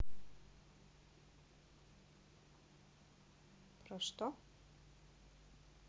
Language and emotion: Russian, neutral